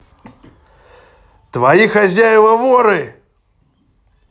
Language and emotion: Russian, angry